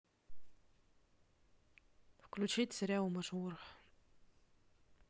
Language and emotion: Russian, neutral